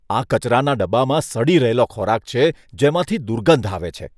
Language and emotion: Gujarati, disgusted